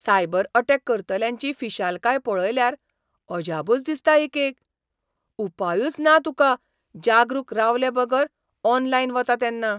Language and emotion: Goan Konkani, surprised